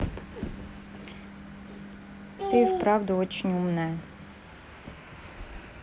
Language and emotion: Russian, neutral